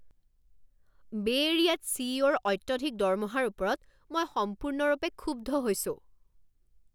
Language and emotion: Assamese, angry